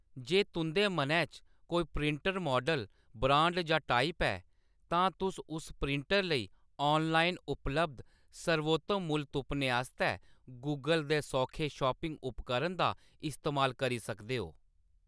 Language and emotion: Dogri, neutral